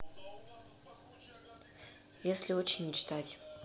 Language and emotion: Russian, neutral